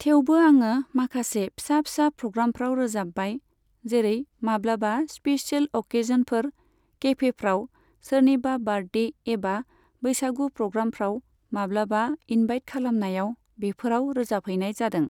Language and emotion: Bodo, neutral